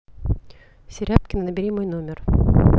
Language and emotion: Russian, neutral